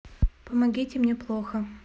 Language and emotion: Russian, neutral